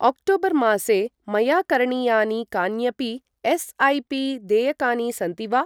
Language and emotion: Sanskrit, neutral